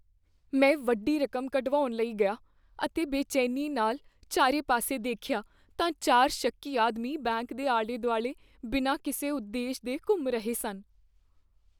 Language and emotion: Punjabi, fearful